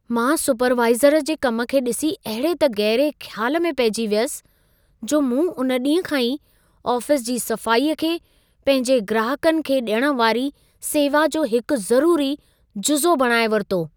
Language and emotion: Sindhi, surprised